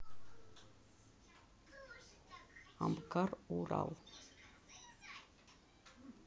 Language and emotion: Russian, neutral